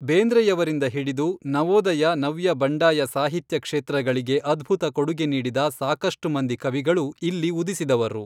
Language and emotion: Kannada, neutral